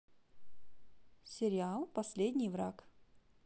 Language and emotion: Russian, positive